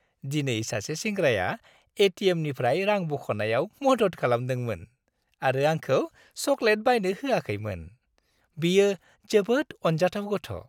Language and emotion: Bodo, happy